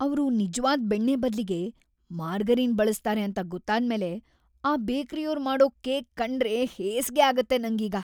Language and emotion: Kannada, disgusted